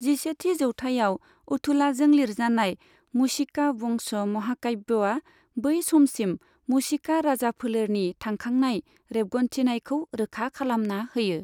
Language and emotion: Bodo, neutral